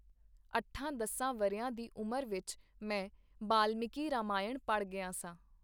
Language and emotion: Punjabi, neutral